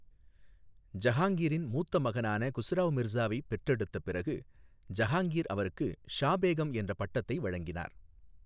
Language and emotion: Tamil, neutral